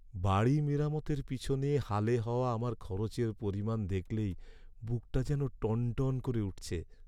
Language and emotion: Bengali, sad